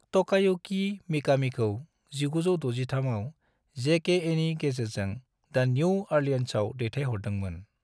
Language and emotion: Bodo, neutral